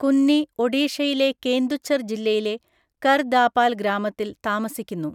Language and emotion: Malayalam, neutral